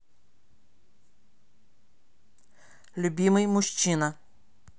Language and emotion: Russian, neutral